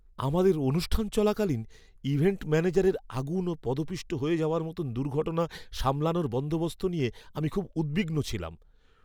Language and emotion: Bengali, fearful